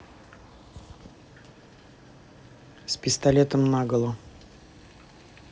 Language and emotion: Russian, neutral